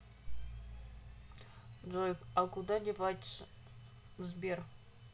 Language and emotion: Russian, neutral